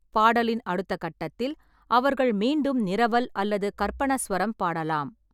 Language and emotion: Tamil, neutral